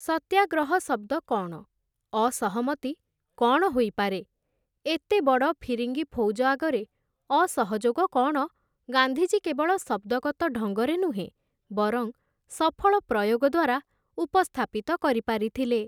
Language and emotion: Odia, neutral